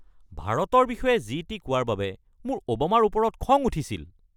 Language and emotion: Assamese, angry